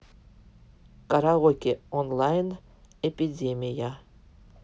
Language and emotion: Russian, neutral